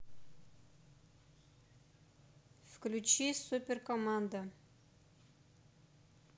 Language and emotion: Russian, neutral